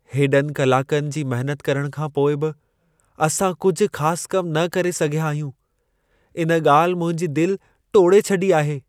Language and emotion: Sindhi, sad